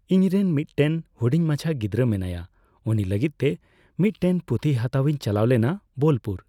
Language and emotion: Santali, neutral